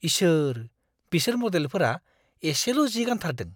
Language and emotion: Bodo, disgusted